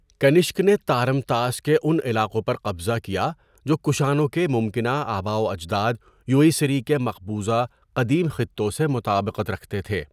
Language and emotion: Urdu, neutral